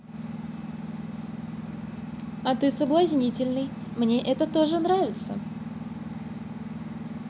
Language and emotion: Russian, positive